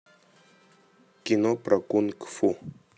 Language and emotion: Russian, neutral